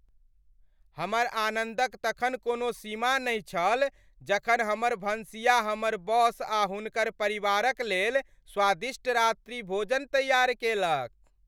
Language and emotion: Maithili, happy